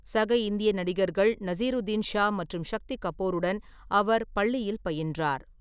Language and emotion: Tamil, neutral